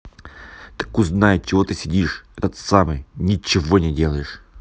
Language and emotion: Russian, angry